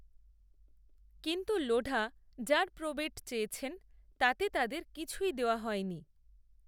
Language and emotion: Bengali, neutral